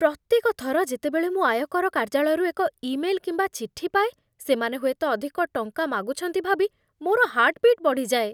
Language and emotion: Odia, fearful